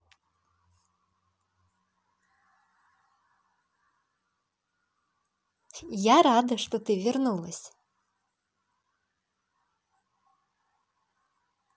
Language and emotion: Russian, positive